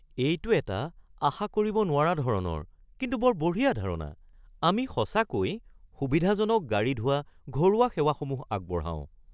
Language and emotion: Assamese, surprised